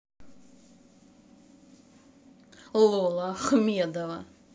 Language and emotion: Russian, angry